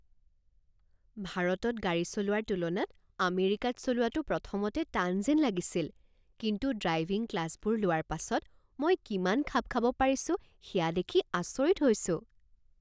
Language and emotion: Assamese, surprised